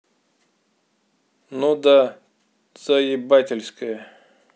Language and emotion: Russian, angry